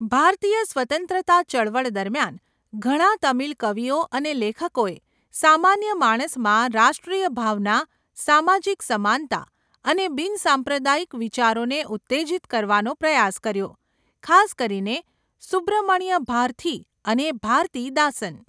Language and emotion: Gujarati, neutral